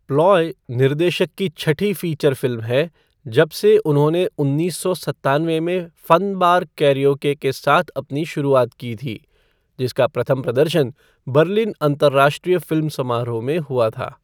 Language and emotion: Hindi, neutral